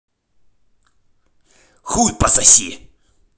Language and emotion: Russian, angry